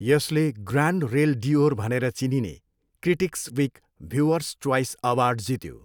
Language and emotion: Nepali, neutral